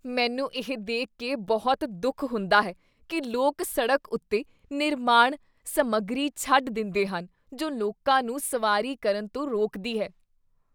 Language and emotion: Punjabi, disgusted